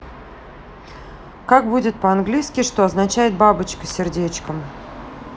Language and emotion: Russian, neutral